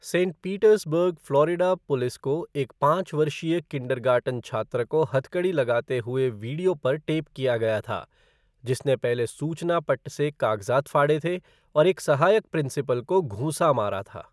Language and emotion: Hindi, neutral